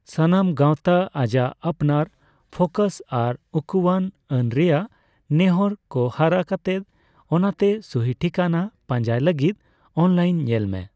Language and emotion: Santali, neutral